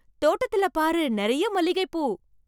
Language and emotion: Tamil, surprised